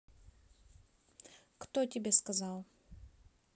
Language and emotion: Russian, neutral